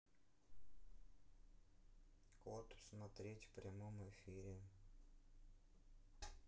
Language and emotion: Russian, neutral